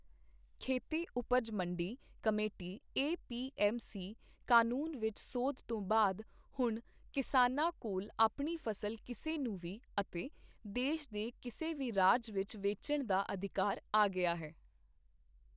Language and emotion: Punjabi, neutral